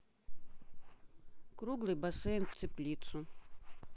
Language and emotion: Russian, neutral